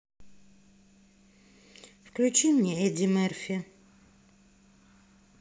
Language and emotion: Russian, neutral